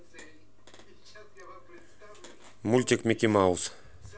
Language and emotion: Russian, neutral